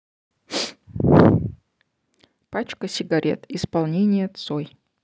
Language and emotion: Russian, neutral